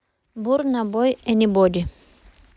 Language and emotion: Russian, neutral